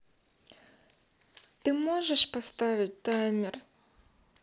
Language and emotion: Russian, sad